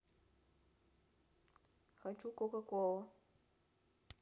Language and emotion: Russian, neutral